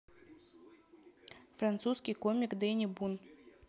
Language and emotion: Russian, neutral